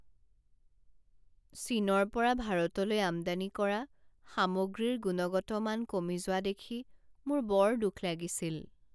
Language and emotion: Assamese, sad